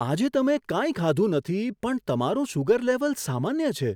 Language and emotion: Gujarati, surprised